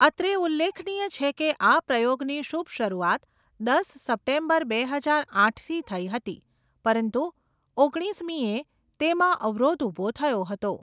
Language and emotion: Gujarati, neutral